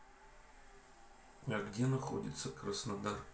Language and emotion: Russian, neutral